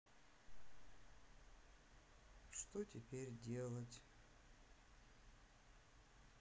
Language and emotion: Russian, sad